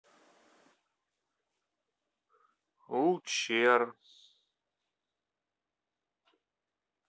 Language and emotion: Russian, neutral